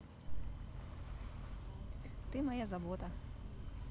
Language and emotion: Russian, neutral